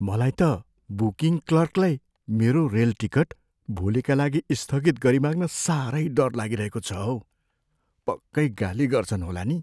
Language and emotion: Nepali, fearful